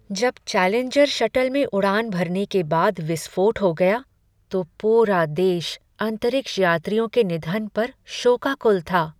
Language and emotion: Hindi, sad